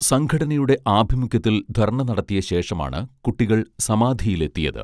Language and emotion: Malayalam, neutral